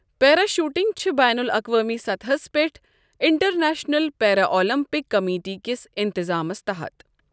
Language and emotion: Kashmiri, neutral